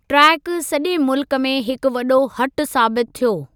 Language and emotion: Sindhi, neutral